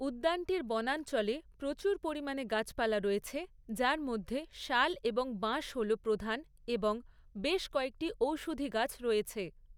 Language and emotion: Bengali, neutral